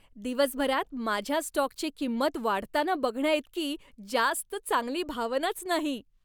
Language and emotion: Marathi, happy